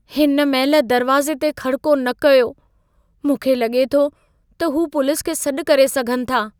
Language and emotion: Sindhi, fearful